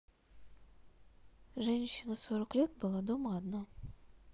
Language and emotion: Russian, neutral